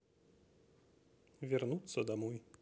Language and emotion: Russian, neutral